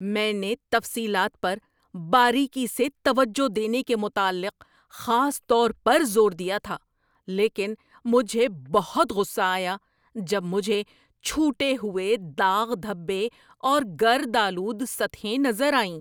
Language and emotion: Urdu, angry